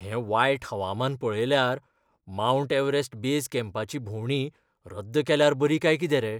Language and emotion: Goan Konkani, fearful